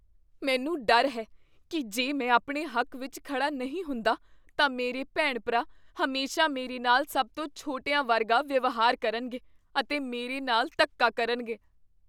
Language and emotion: Punjabi, fearful